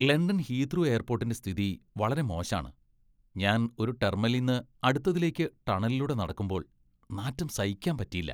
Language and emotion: Malayalam, disgusted